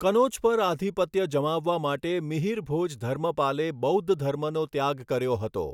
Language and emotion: Gujarati, neutral